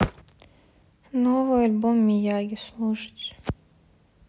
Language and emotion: Russian, sad